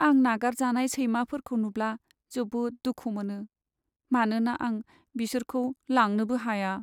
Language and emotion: Bodo, sad